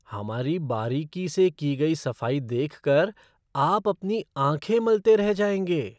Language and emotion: Hindi, surprised